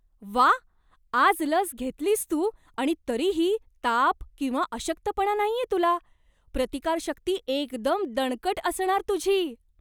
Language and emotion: Marathi, surprised